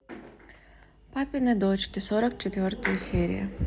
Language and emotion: Russian, neutral